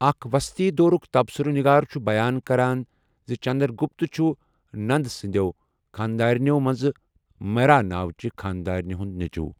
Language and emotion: Kashmiri, neutral